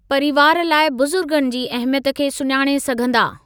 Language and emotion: Sindhi, neutral